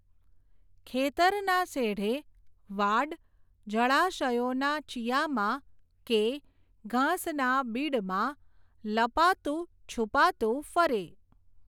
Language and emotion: Gujarati, neutral